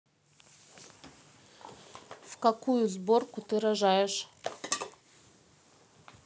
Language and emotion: Russian, neutral